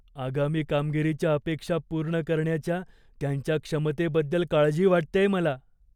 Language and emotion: Marathi, fearful